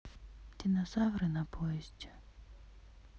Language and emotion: Russian, sad